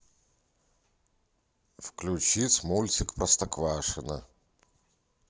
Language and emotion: Russian, neutral